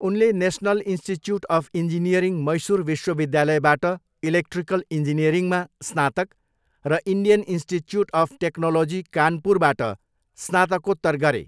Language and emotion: Nepali, neutral